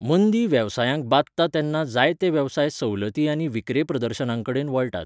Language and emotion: Goan Konkani, neutral